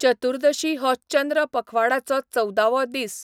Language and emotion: Goan Konkani, neutral